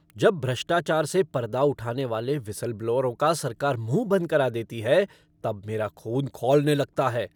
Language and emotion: Hindi, angry